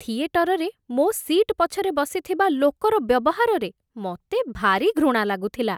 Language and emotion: Odia, disgusted